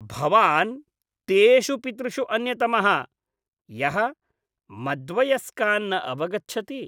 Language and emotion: Sanskrit, disgusted